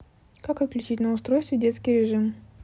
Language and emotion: Russian, neutral